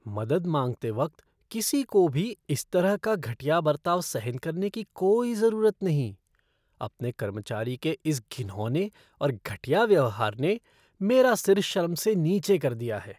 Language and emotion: Hindi, disgusted